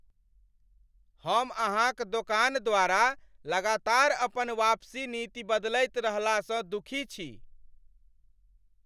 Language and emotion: Maithili, angry